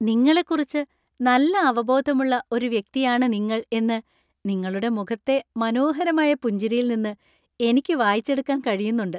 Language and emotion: Malayalam, happy